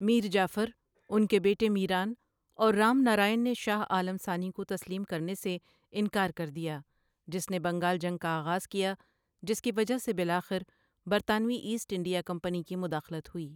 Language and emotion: Urdu, neutral